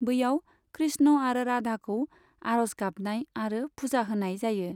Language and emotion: Bodo, neutral